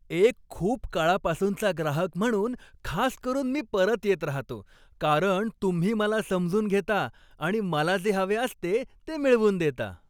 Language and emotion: Marathi, happy